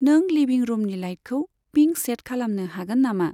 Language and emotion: Bodo, neutral